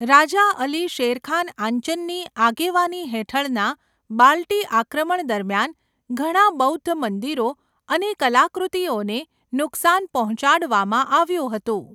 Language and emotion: Gujarati, neutral